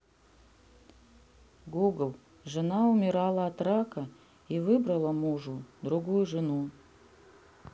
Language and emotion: Russian, neutral